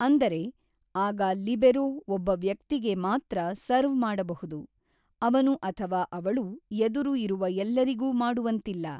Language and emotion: Kannada, neutral